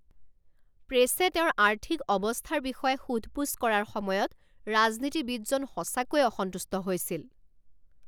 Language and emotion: Assamese, angry